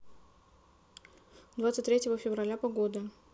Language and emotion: Russian, neutral